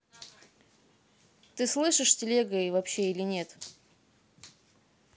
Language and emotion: Russian, angry